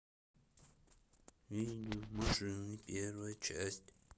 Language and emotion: Russian, neutral